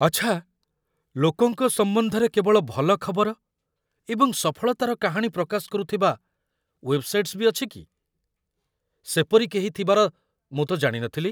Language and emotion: Odia, surprised